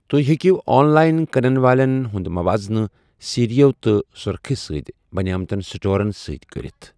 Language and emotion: Kashmiri, neutral